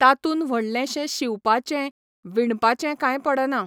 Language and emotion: Goan Konkani, neutral